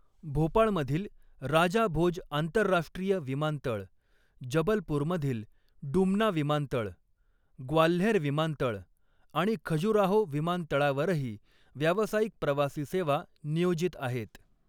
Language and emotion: Marathi, neutral